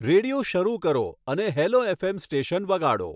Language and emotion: Gujarati, neutral